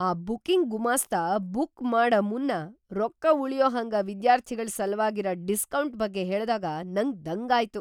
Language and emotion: Kannada, surprised